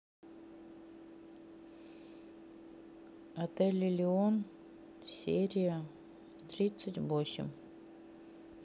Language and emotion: Russian, neutral